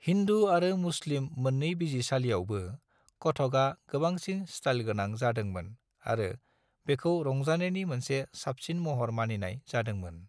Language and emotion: Bodo, neutral